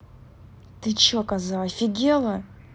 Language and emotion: Russian, angry